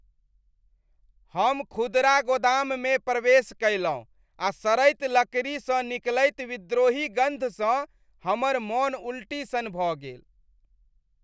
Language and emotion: Maithili, disgusted